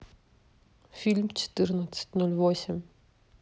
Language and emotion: Russian, neutral